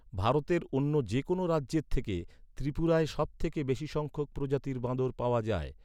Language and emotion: Bengali, neutral